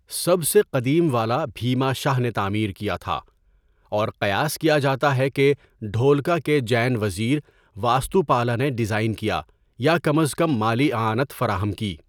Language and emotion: Urdu, neutral